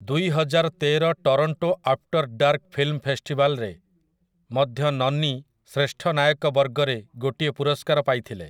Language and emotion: Odia, neutral